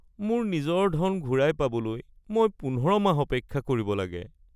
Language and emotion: Assamese, sad